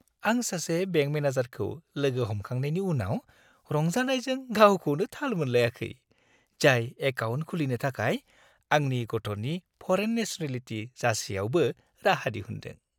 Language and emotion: Bodo, happy